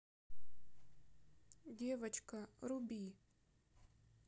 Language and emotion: Russian, sad